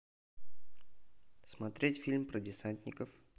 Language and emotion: Russian, neutral